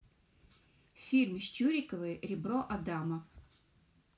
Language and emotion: Russian, neutral